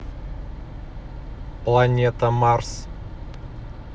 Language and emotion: Russian, neutral